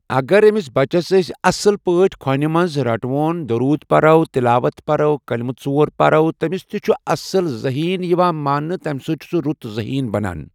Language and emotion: Kashmiri, neutral